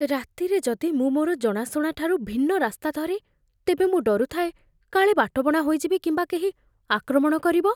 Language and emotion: Odia, fearful